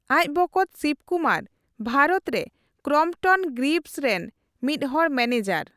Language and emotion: Santali, neutral